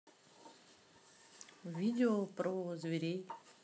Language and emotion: Russian, neutral